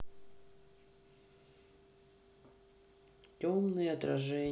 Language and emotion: Russian, sad